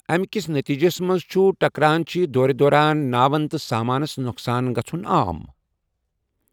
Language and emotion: Kashmiri, neutral